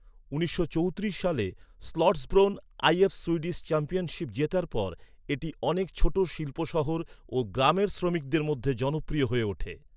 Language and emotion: Bengali, neutral